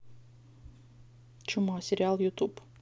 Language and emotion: Russian, neutral